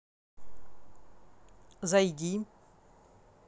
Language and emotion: Russian, neutral